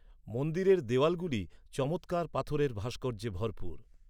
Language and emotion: Bengali, neutral